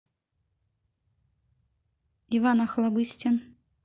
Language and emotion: Russian, neutral